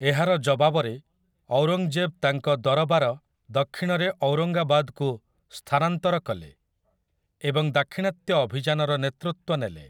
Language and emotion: Odia, neutral